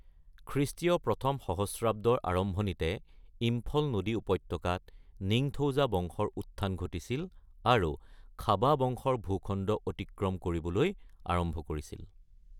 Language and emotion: Assamese, neutral